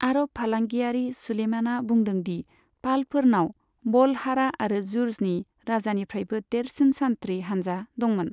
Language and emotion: Bodo, neutral